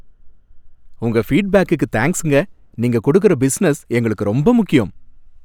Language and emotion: Tamil, happy